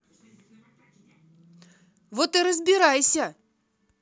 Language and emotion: Russian, angry